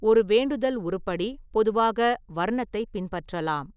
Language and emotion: Tamil, neutral